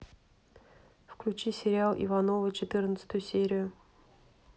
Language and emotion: Russian, neutral